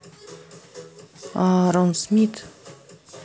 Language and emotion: Russian, neutral